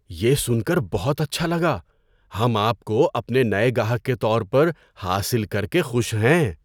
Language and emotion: Urdu, surprised